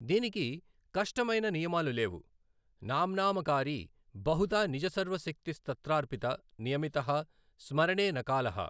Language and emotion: Telugu, neutral